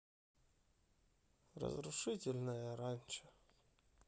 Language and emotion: Russian, sad